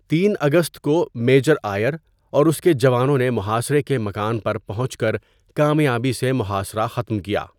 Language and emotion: Urdu, neutral